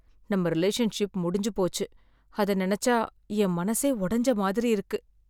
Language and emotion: Tamil, sad